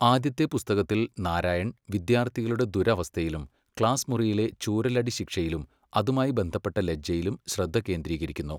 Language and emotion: Malayalam, neutral